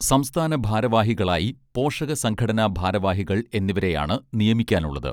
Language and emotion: Malayalam, neutral